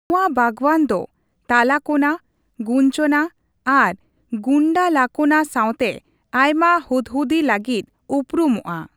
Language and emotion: Santali, neutral